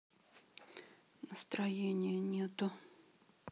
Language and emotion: Russian, sad